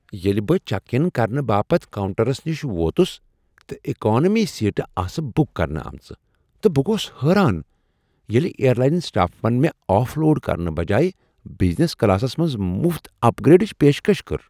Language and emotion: Kashmiri, surprised